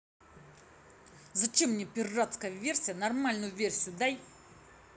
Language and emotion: Russian, angry